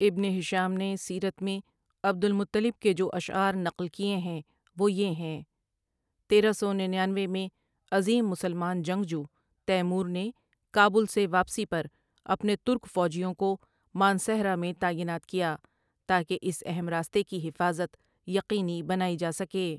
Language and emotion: Urdu, neutral